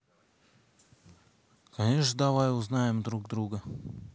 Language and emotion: Russian, neutral